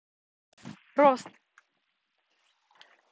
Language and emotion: Russian, neutral